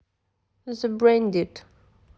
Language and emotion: Russian, neutral